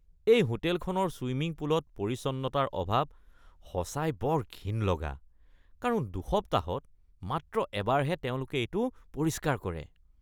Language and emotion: Assamese, disgusted